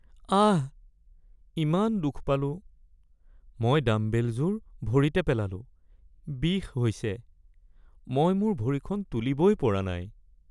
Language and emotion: Assamese, sad